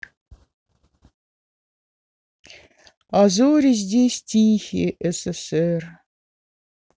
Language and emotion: Russian, sad